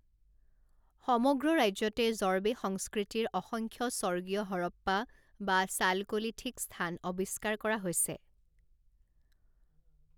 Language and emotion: Assamese, neutral